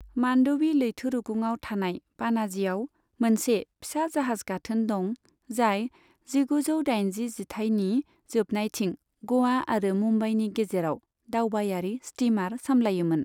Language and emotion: Bodo, neutral